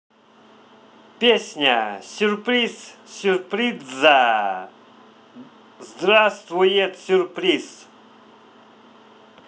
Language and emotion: Russian, positive